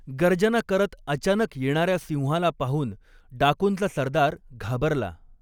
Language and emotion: Marathi, neutral